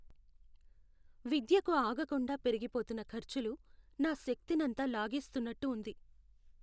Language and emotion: Telugu, sad